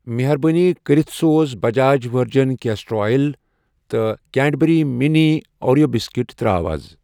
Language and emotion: Kashmiri, neutral